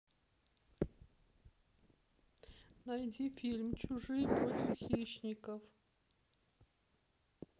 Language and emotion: Russian, sad